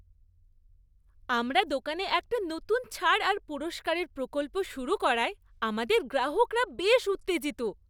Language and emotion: Bengali, happy